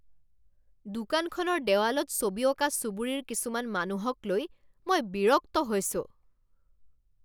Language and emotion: Assamese, angry